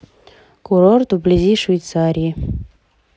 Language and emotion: Russian, neutral